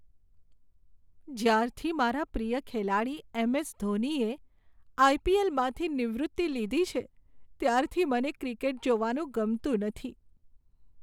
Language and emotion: Gujarati, sad